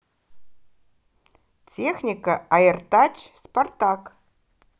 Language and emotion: Russian, positive